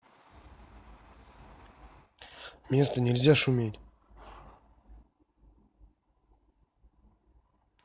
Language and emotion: Russian, neutral